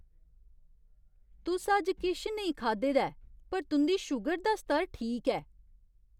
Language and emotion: Dogri, surprised